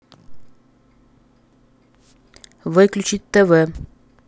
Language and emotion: Russian, angry